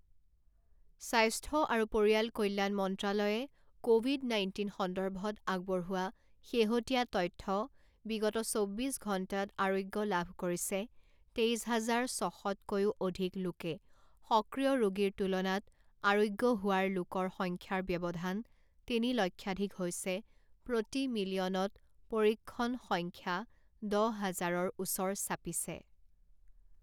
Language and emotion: Assamese, neutral